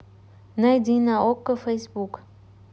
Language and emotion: Russian, neutral